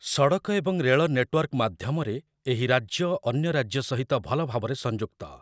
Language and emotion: Odia, neutral